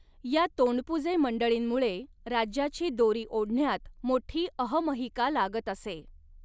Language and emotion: Marathi, neutral